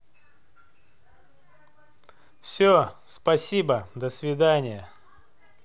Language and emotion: Russian, neutral